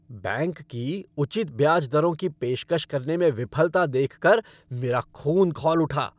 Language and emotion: Hindi, angry